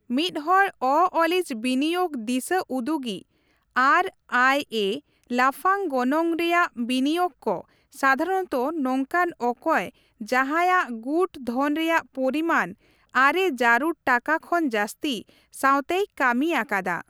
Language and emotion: Santali, neutral